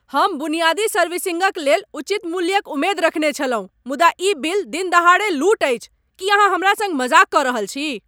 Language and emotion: Maithili, angry